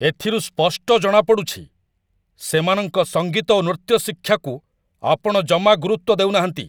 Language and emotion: Odia, angry